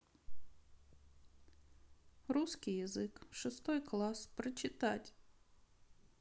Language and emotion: Russian, sad